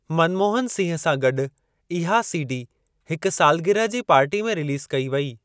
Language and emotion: Sindhi, neutral